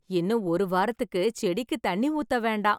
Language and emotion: Tamil, happy